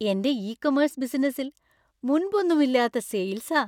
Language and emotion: Malayalam, happy